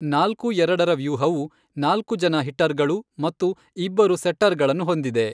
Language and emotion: Kannada, neutral